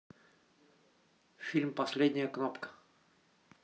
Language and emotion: Russian, neutral